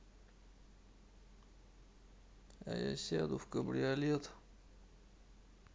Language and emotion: Russian, sad